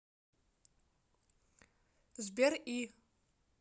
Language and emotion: Russian, neutral